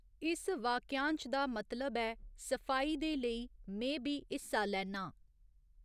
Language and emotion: Dogri, neutral